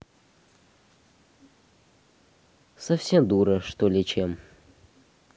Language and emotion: Russian, neutral